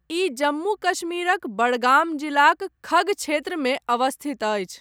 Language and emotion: Maithili, neutral